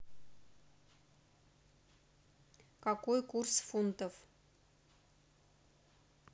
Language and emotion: Russian, neutral